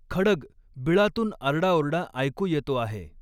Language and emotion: Marathi, neutral